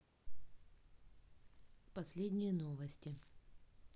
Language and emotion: Russian, neutral